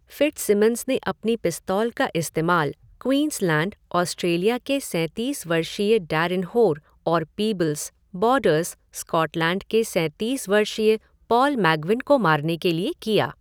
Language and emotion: Hindi, neutral